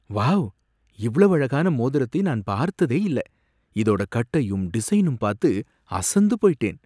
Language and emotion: Tamil, surprised